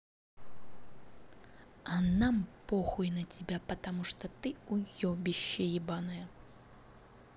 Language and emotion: Russian, angry